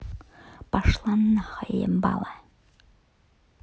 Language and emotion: Russian, angry